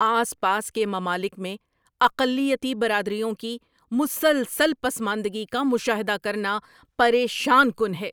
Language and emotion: Urdu, angry